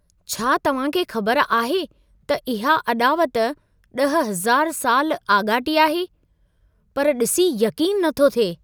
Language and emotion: Sindhi, surprised